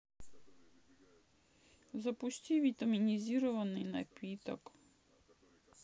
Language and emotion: Russian, sad